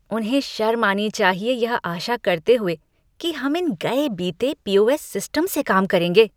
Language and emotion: Hindi, disgusted